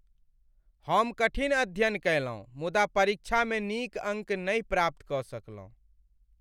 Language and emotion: Maithili, sad